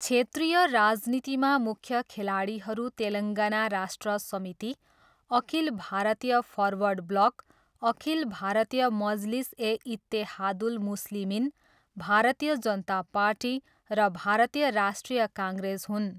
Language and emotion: Nepali, neutral